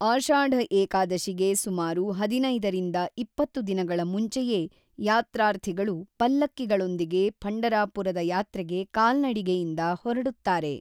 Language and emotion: Kannada, neutral